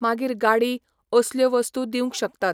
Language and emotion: Goan Konkani, neutral